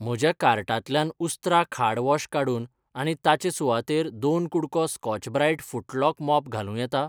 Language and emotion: Goan Konkani, neutral